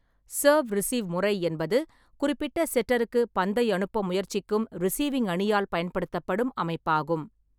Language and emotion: Tamil, neutral